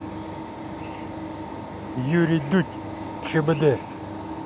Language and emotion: Russian, neutral